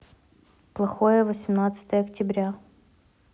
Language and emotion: Russian, neutral